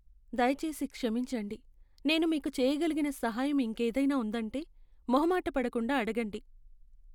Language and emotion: Telugu, sad